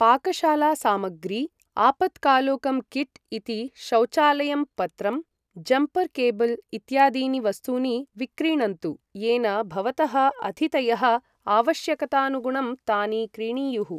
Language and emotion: Sanskrit, neutral